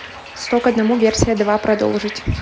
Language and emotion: Russian, neutral